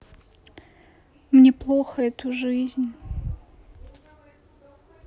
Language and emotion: Russian, sad